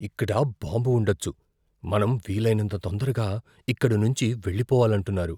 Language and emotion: Telugu, fearful